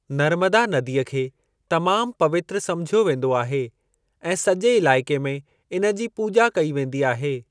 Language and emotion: Sindhi, neutral